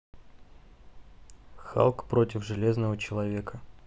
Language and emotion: Russian, neutral